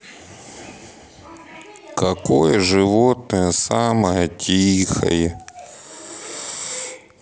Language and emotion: Russian, sad